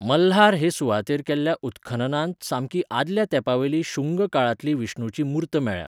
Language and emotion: Goan Konkani, neutral